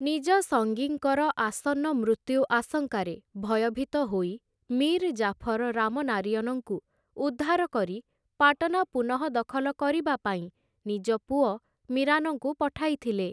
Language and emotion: Odia, neutral